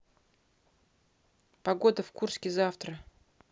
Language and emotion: Russian, neutral